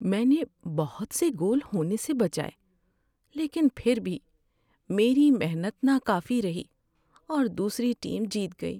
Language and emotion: Urdu, sad